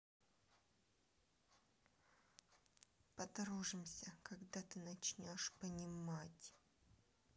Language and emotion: Russian, angry